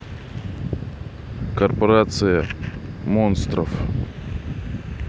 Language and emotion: Russian, neutral